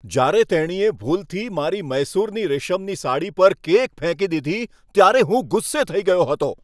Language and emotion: Gujarati, angry